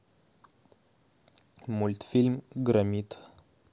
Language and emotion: Russian, neutral